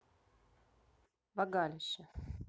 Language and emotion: Russian, neutral